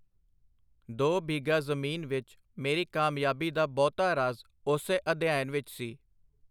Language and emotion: Punjabi, neutral